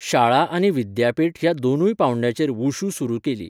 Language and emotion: Goan Konkani, neutral